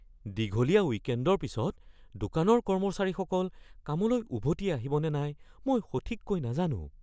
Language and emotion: Assamese, fearful